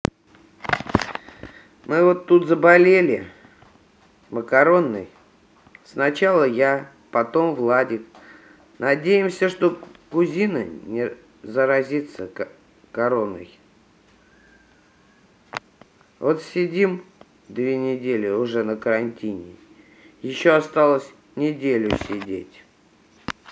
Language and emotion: Russian, sad